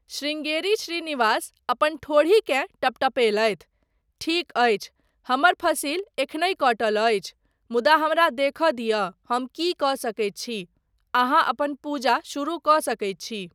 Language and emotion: Maithili, neutral